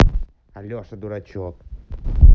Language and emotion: Russian, angry